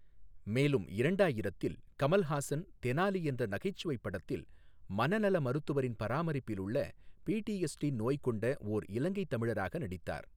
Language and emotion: Tamil, neutral